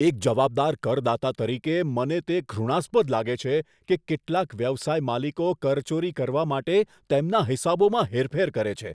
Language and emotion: Gujarati, disgusted